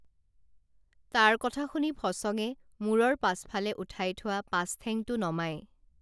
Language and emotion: Assamese, neutral